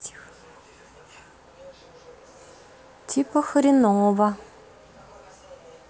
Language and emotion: Russian, neutral